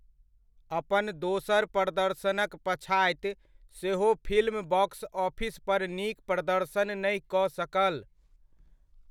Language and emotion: Maithili, neutral